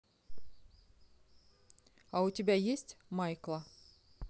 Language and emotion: Russian, neutral